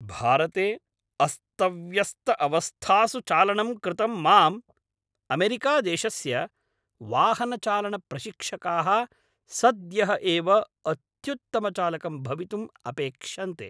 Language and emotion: Sanskrit, angry